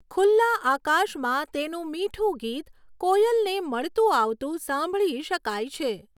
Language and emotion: Gujarati, neutral